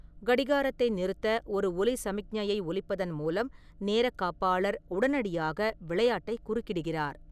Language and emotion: Tamil, neutral